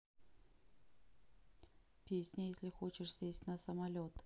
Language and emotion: Russian, neutral